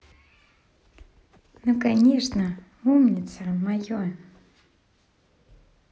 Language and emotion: Russian, positive